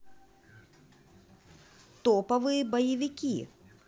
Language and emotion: Russian, positive